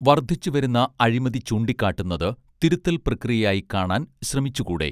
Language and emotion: Malayalam, neutral